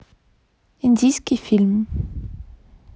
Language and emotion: Russian, neutral